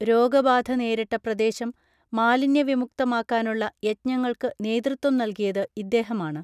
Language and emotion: Malayalam, neutral